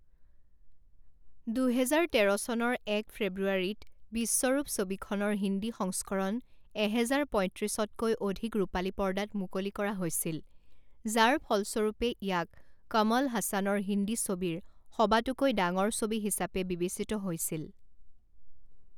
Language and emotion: Assamese, neutral